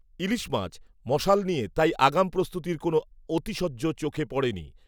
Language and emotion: Bengali, neutral